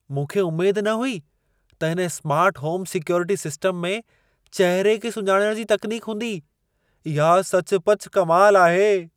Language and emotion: Sindhi, surprised